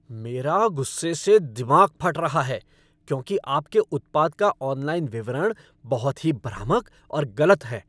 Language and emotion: Hindi, angry